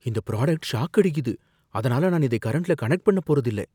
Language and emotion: Tamil, fearful